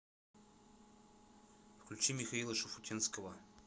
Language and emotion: Russian, neutral